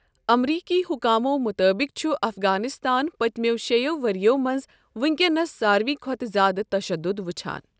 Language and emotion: Kashmiri, neutral